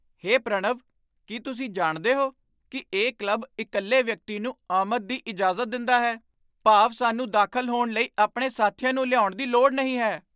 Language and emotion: Punjabi, surprised